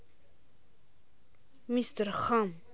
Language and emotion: Russian, neutral